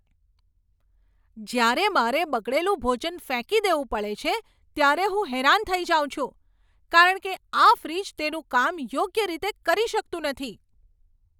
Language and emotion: Gujarati, angry